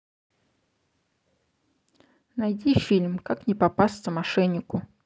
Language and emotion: Russian, neutral